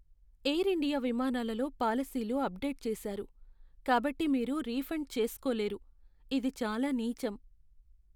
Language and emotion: Telugu, sad